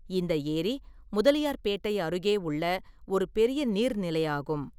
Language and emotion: Tamil, neutral